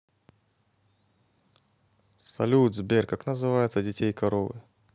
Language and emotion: Russian, positive